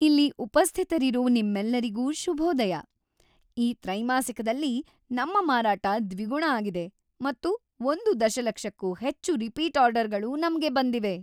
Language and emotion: Kannada, happy